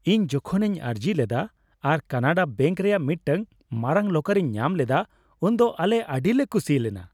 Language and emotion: Santali, happy